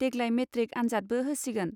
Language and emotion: Bodo, neutral